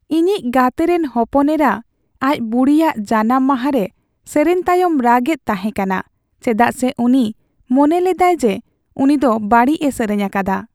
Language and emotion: Santali, sad